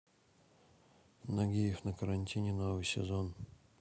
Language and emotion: Russian, neutral